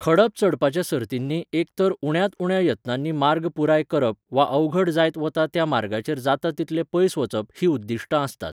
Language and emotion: Goan Konkani, neutral